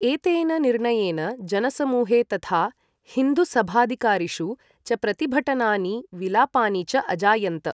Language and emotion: Sanskrit, neutral